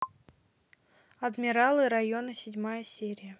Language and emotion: Russian, neutral